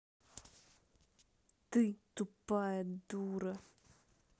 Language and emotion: Russian, angry